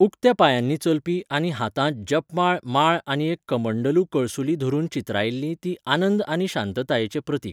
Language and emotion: Goan Konkani, neutral